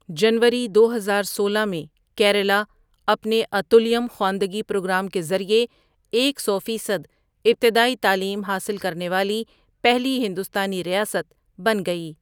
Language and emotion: Urdu, neutral